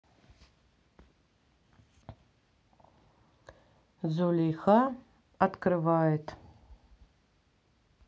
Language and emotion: Russian, neutral